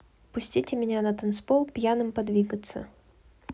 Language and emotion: Russian, neutral